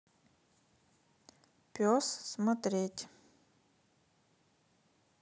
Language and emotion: Russian, neutral